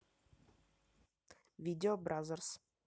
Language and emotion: Russian, neutral